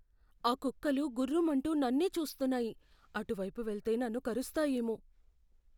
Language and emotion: Telugu, fearful